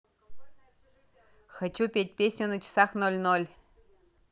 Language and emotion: Russian, positive